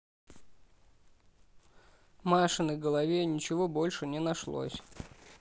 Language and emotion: Russian, neutral